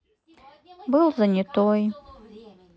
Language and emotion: Russian, sad